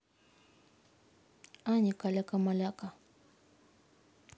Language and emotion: Russian, neutral